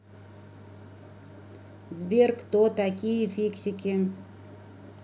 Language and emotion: Russian, neutral